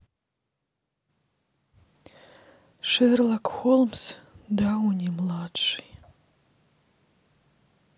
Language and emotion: Russian, sad